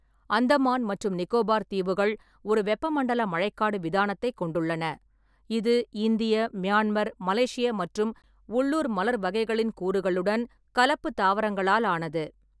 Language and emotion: Tamil, neutral